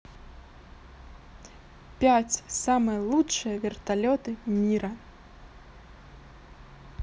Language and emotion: Russian, positive